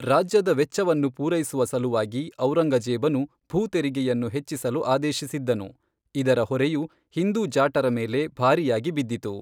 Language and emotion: Kannada, neutral